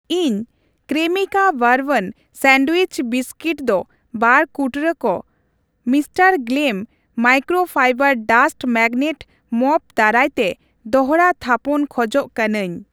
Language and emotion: Santali, neutral